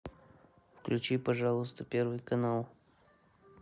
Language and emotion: Russian, neutral